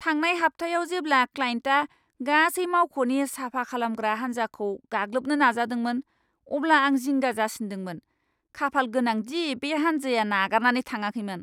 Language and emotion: Bodo, angry